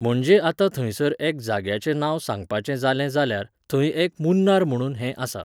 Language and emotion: Goan Konkani, neutral